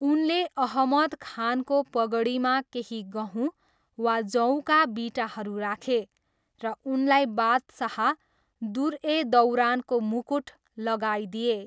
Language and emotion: Nepali, neutral